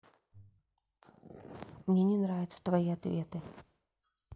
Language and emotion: Russian, neutral